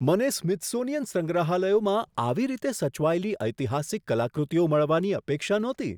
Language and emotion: Gujarati, surprised